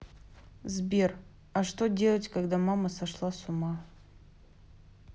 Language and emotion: Russian, neutral